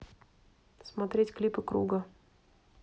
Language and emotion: Russian, neutral